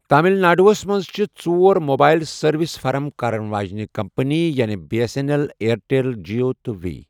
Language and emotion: Kashmiri, neutral